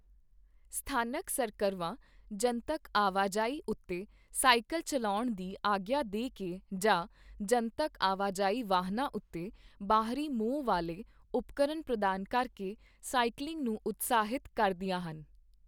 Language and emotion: Punjabi, neutral